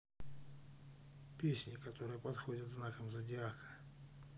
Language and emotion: Russian, neutral